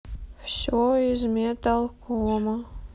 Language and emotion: Russian, sad